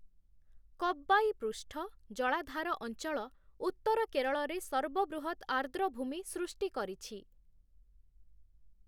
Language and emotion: Odia, neutral